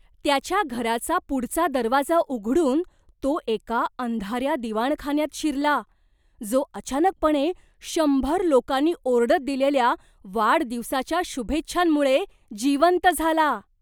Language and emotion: Marathi, surprised